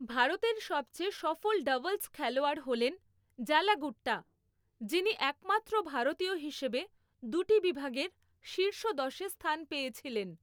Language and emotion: Bengali, neutral